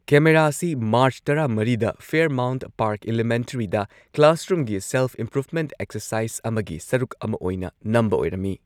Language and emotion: Manipuri, neutral